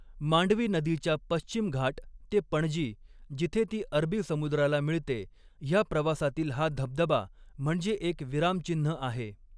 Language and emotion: Marathi, neutral